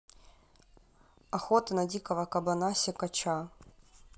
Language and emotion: Russian, neutral